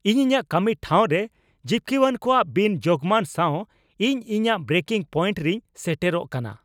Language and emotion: Santali, angry